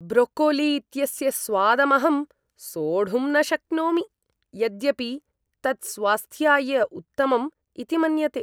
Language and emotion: Sanskrit, disgusted